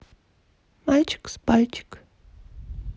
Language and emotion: Russian, neutral